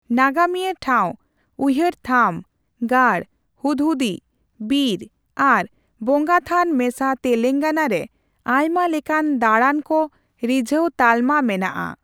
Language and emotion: Santali, neutral